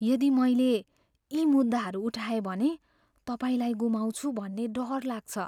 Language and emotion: Nepali, fearful